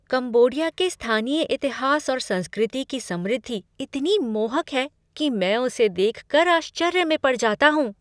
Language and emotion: Hindi, surprised